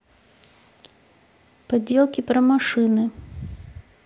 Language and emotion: Russian, neutral